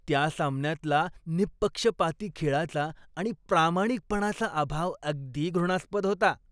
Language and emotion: Marathi, disgusted